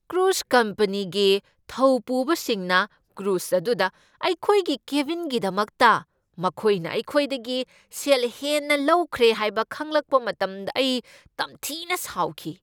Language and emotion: Manipuri, angry